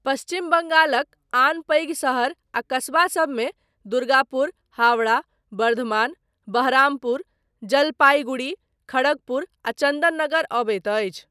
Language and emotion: Maithili, neutral